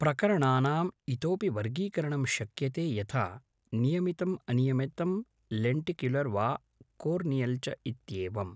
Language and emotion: Sanskrit, neutral